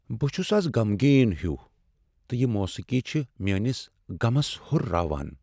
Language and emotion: Kashmiri, sad